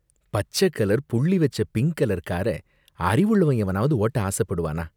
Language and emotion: Tamil, disgusted